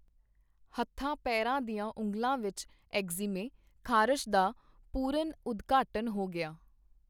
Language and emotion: Punjabi, neutral